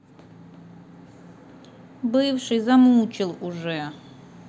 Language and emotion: Russian, sad